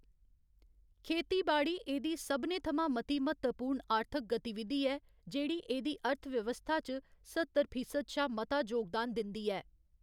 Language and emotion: Dogri, neutral